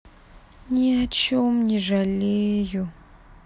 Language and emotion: Russian, sad